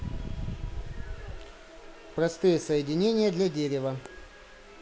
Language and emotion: Russian, neutral